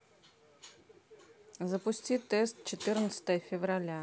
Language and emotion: Russian, neutral